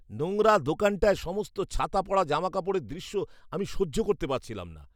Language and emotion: Bengali, disgusted